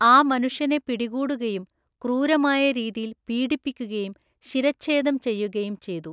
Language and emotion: Malayalam, neutral